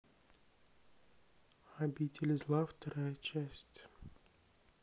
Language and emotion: Russian, sad